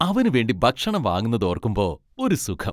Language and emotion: Malayalam, happy